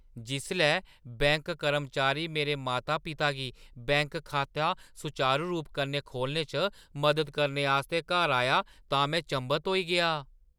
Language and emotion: Dogri, surprised